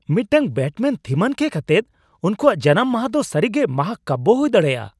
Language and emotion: Santali, surprised